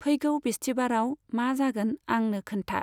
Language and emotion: Bodo, neutral